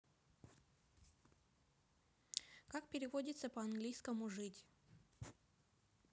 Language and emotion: Russian, neutral